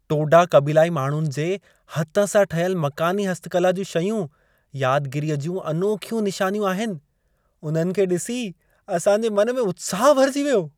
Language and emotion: Sindhi, happy